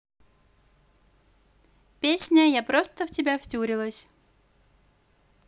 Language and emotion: Russian, positive